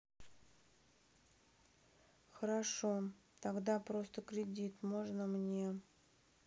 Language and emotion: Russian, sad